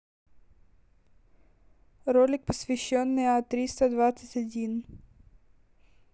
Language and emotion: Russian, neutral